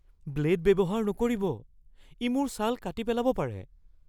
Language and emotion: Assamese, fearful